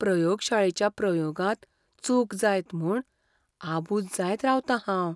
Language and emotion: Goan Konkani, fearful